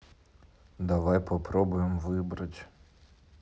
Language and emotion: Russian, neutral